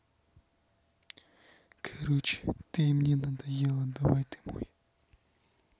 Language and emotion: Russian, neutral